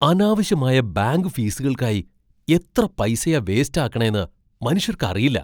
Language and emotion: Malayalam, surprised